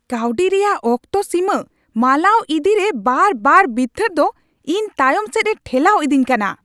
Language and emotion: Santali, angry